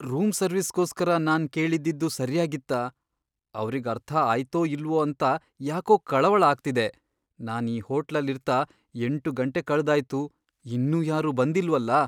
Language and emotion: Kannada, fearful